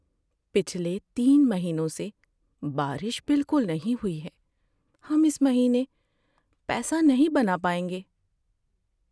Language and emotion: Urdu, sad